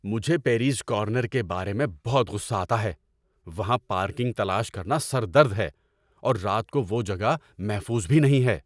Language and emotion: Urdu, angry